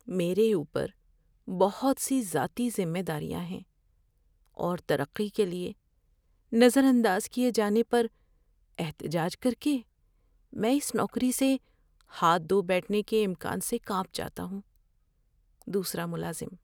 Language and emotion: Urdu, fearful